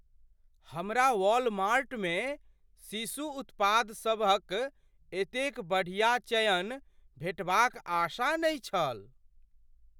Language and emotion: Maithili, surprised